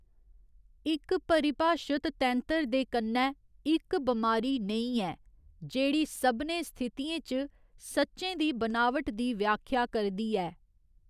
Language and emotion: Dogri, neutral